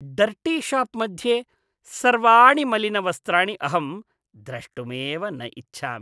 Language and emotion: Sanskrit, disgusted